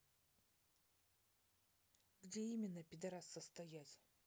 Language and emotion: Russian, angry